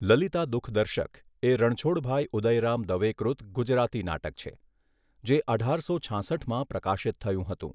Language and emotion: Gujarati, neutral